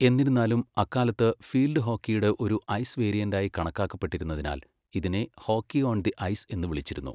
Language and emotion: Malayalam, neutral